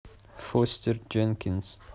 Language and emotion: Russian, neutral